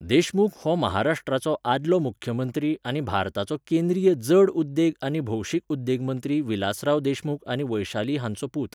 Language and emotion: Goan Konkani, neutral